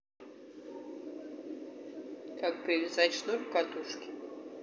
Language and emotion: Russian, neutral